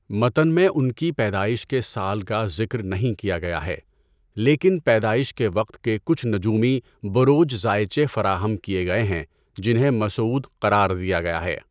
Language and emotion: Urdu, neutral